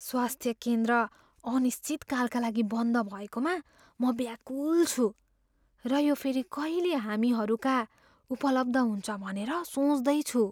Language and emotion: Nepali, fearful